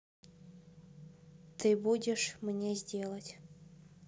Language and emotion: Russian, neutral